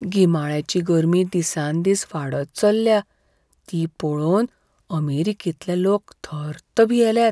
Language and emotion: Goan Konkani, fearful